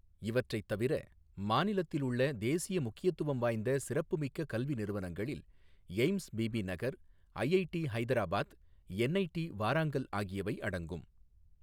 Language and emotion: Tamil, neutral